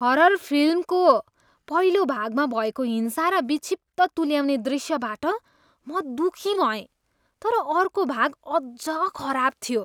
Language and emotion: Nepali, disgusted